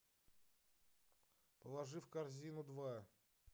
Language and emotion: Russian, angry